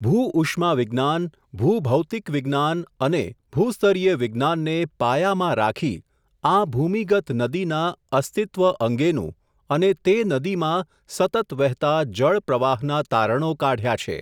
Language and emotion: Gujarati, neutral